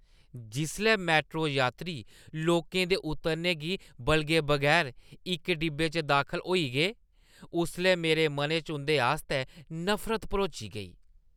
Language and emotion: Dogri, disgusted